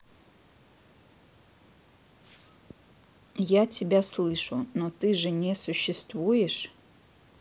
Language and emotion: Russian, neutral